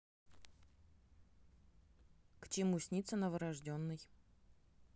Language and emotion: Russian, neutral